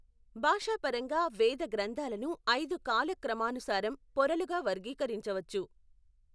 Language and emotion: Telugu, neutral